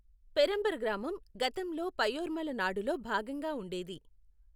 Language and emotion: Telugu, neutral